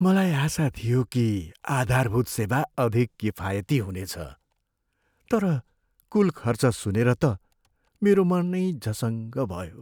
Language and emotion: Nepali, sad